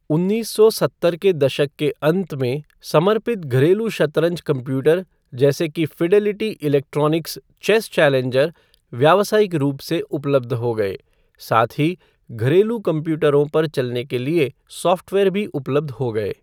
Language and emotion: Hindi, neutral